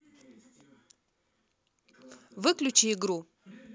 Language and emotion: Russian, neutral